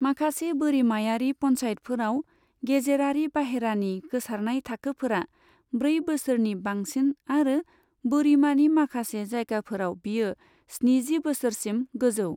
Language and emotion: Bodo, neutral